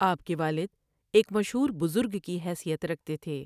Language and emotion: Urdu, neutral